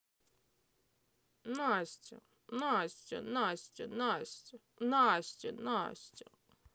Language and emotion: Russian, neutral